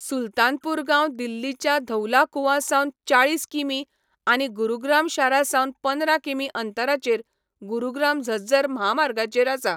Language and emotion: Goan Konkani, neutral